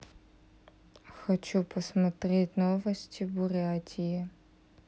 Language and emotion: Russian, neutral